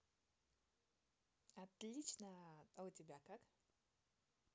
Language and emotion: Russian, positive